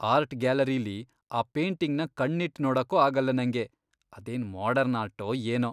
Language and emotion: Kannada, disgusted